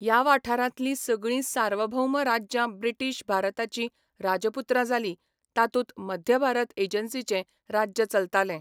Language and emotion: Goan Konkani, neutral